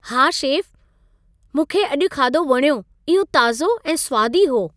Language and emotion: Sindhi, happy